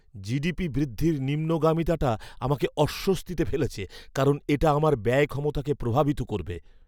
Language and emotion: Bengali, fearful